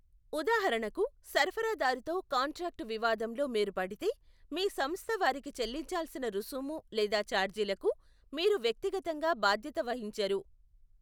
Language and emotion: Telugu, neutral